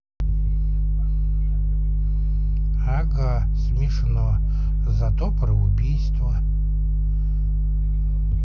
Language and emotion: Russian, neutral